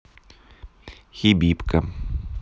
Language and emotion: Russian, neutral